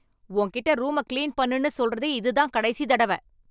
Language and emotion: Tamil, angry